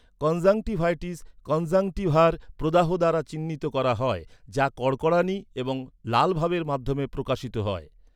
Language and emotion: Bengali, neutral